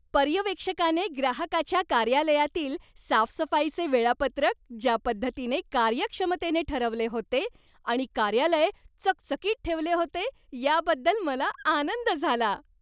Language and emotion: Marathi, happy